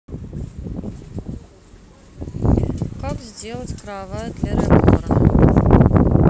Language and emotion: Russian, neutral